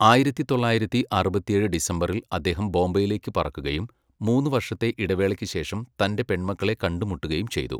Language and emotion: Malayalam, neutral